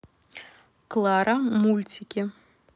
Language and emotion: Russian, neutral